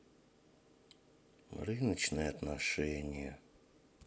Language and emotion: Russian, sad